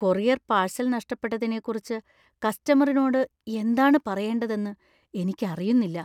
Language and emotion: Malayalam, fearful